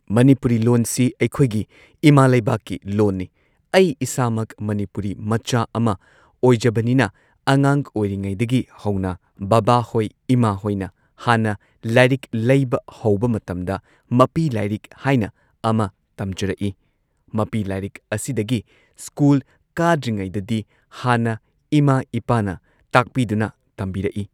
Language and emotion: Manipuri, neutral